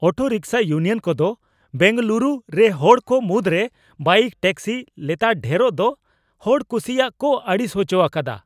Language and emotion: Santali, angry